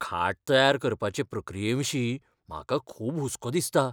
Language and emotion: Goan Konkani, fearful